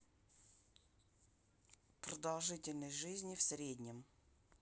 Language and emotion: Russian, neutral